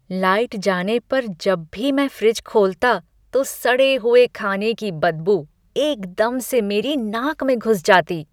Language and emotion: Hindi, disgusted